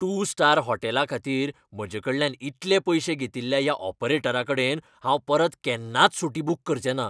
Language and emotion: Goan Konkani, angry